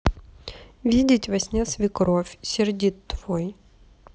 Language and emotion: Russian, neutral